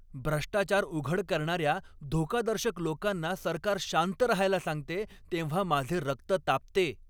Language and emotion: Marathi, angry